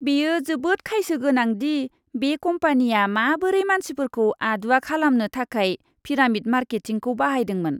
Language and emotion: Bodo, disgusted